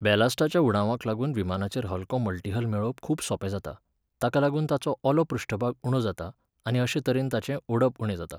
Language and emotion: Goan Konkani, neutral